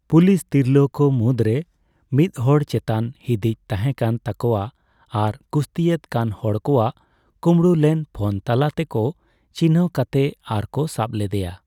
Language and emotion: Santali, neutral